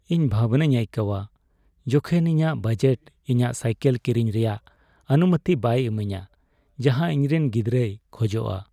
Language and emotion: Santali, sad